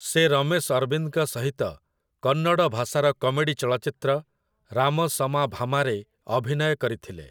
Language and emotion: Odia, neutral